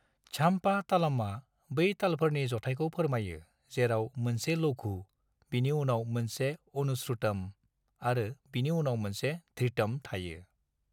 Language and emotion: Bodo, neutral